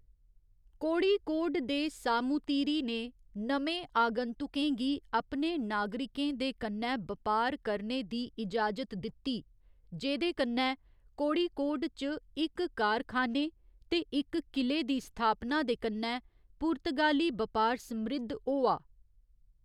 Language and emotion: Dogri, neutral